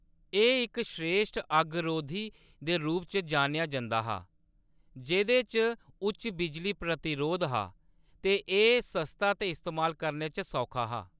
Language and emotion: Dogri, neutral